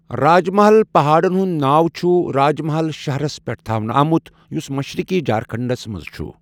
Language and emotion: Kashmiri, neutral